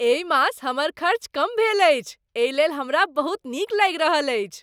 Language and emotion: Maithili, happy